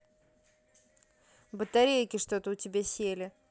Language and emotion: Russian, neutral